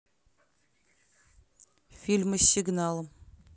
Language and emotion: Russian, neutral